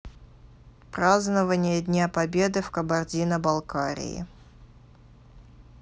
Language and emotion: Russian, neutral